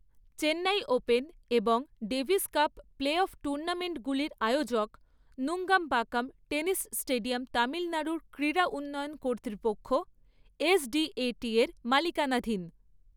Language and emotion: Bengali, neutral